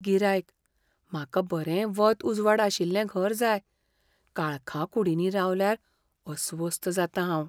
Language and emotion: Goan Konkani, fearful